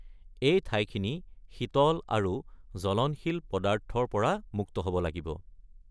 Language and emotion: Assamese, neutral